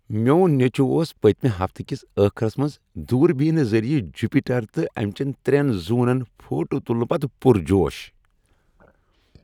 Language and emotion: Kashmiri, happy